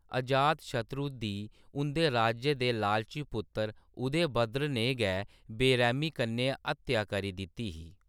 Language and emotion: Dogri, neutral